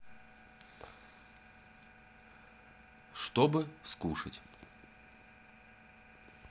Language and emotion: Russian, neutral